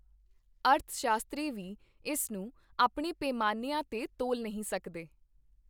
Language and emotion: Punjabi, neutral